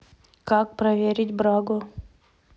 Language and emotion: Russian, neutral